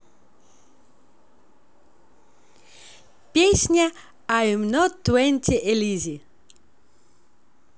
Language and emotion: Russian, positive